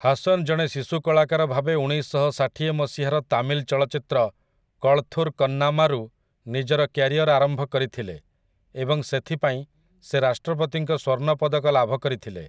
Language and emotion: Odia, neutral